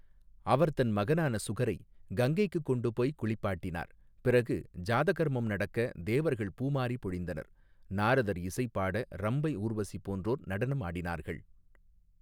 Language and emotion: Tamil, neutral